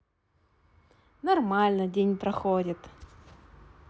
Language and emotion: Russian, positive